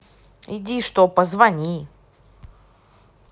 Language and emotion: Russian, angry